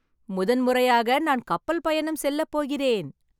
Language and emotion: Tamil, happy